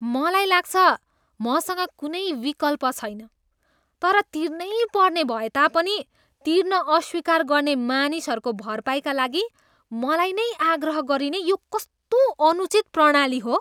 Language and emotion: Nepali, disgusted